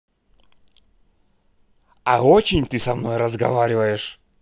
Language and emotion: Russian, angry